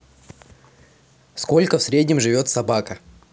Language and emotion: Russian, neutral